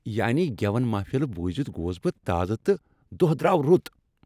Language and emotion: Kashmiri, happy